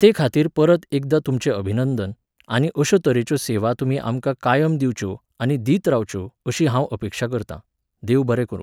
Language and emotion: Goan Konkani, neutral